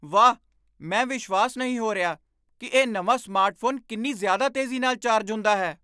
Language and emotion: Punjabi, surprised